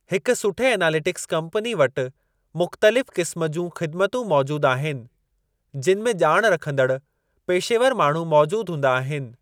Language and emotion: Sindhi, neutral